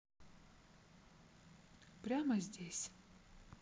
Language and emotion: Russian, neutral